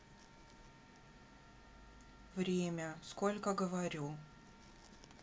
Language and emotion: Russian, neutral